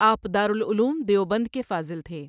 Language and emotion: Urdu, neutral